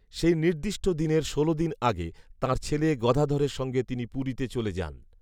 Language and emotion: Bengali, neutral